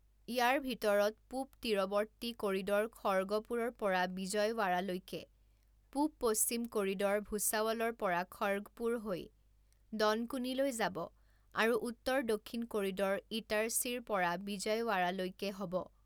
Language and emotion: Assamese, neutral